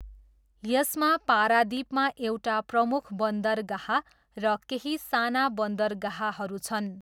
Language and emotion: Nepali, neutral